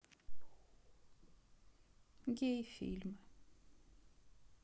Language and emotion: Russian, sad